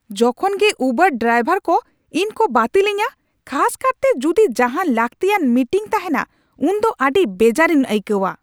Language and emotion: Santali, angry